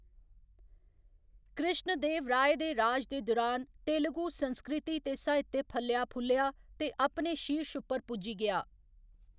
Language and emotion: Dogri, neutral